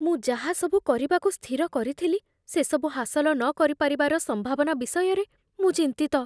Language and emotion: Odia, fearful